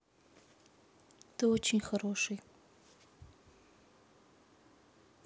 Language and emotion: Russian, sad